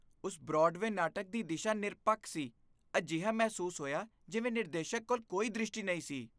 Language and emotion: Punjabi, disgusted